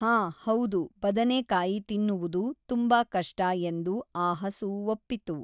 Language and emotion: Kannada, neutral